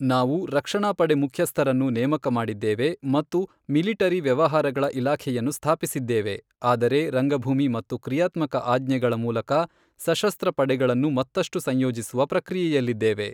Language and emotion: Kannada, neutral